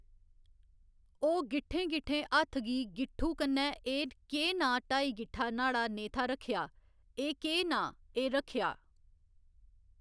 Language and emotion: Dogri, neutral